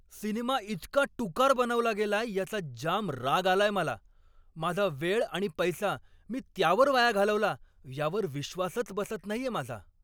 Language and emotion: Marathi, angry